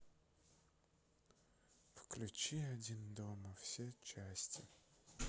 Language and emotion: Russian, sad